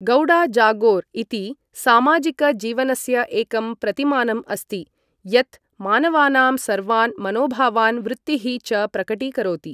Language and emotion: Sanskrit, neutral